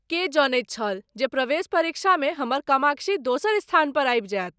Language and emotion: Maithili, surprised